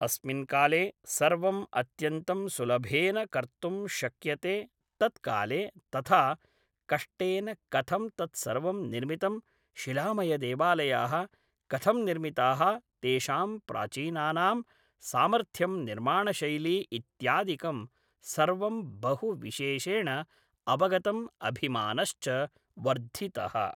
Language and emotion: Sanskrit, neutral